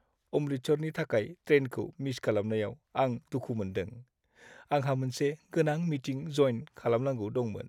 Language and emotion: Bodo, sad